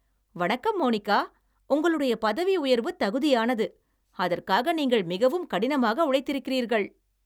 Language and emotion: Tamil, happy